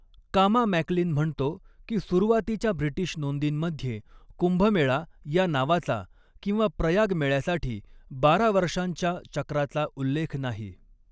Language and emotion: Marathi, neutral